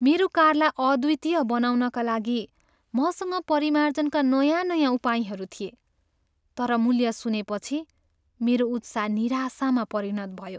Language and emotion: Nepali, sad